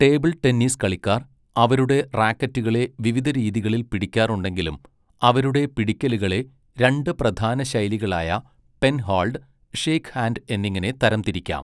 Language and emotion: Malayalam, neutral